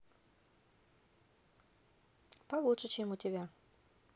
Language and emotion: Russian, neutral